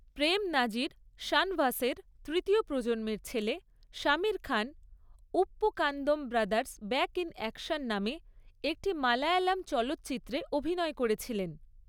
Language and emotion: Bengali, neutral